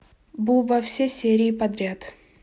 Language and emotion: Russian, neutral